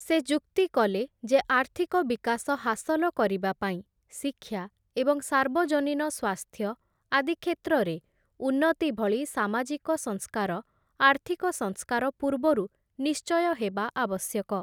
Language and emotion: Odia, neutral